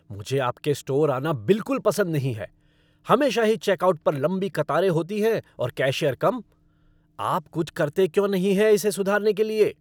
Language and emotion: Hindi, angry